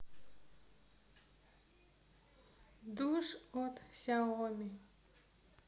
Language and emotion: Russian, neutral